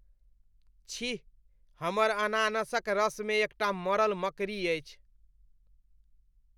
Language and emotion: Maithili, disgusted